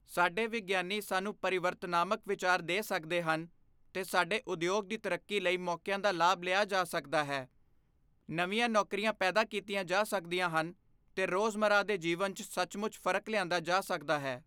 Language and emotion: Punjabi, neutral